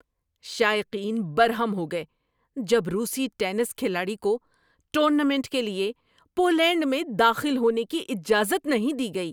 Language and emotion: Urdu, angry